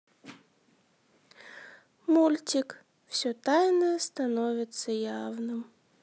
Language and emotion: Russian, sad